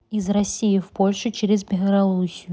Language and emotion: Russian, neutral